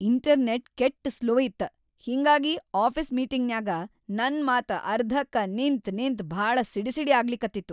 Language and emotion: Kannada, angry